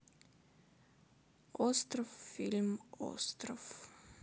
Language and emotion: Russian, sad